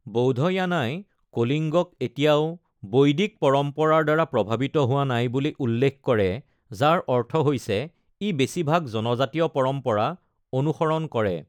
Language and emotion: Assamese, neutral